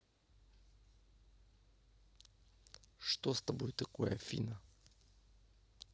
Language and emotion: Russian, neutral